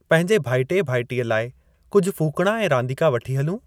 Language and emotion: Sindhi, neutral